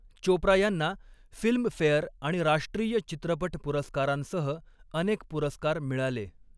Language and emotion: Marathi, neutral